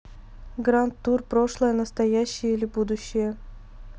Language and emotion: Russian, neutral